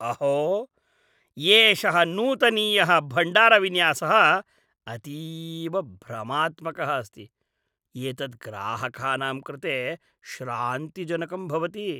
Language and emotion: Sanskrit, disgusted